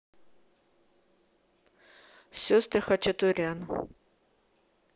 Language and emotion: Russian, neutral